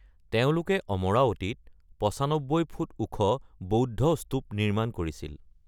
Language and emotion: Assamese, neutral